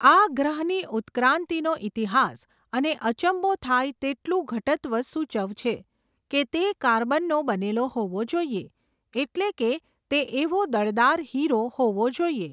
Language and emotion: Gujarati, neutral